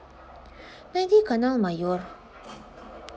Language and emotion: Russian, neutral